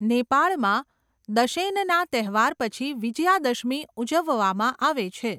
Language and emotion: Gujarati, neutral